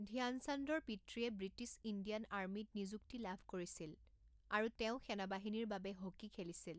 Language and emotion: Assamese, neutral